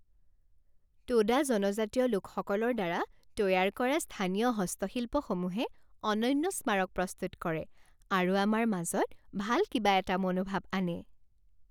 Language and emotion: Assamese, happy